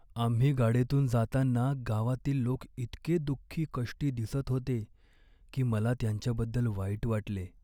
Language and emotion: Marathi, sad